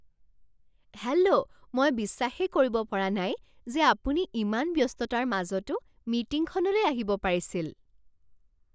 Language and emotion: Assamese, surprised